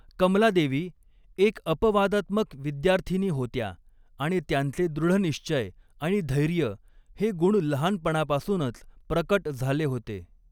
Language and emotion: Marathi, neutral